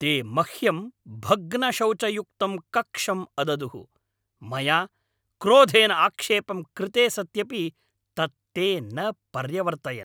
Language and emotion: Sanskrit, angry